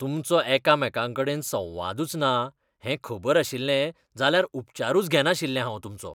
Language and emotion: Goan Konkani, disgusted